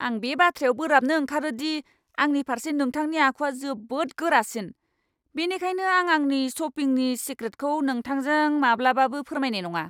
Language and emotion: Bodo, angry